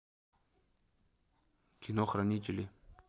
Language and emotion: Russian, neutral